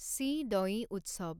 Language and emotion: Assamese, neutral